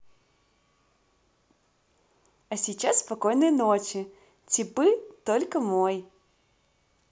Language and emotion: Russian, positive